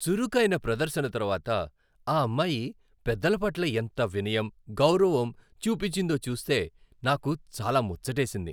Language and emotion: Telugu, happy